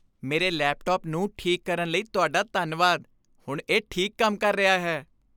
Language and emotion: Punjabi, happy